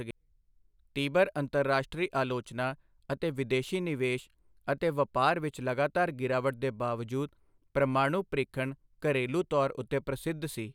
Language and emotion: Punjabi, neutral